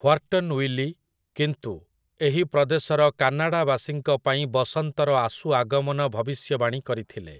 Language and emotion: Odia, neutral